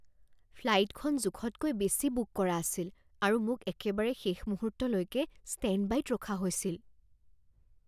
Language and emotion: Assamese, fearful